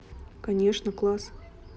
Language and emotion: Russian, neutral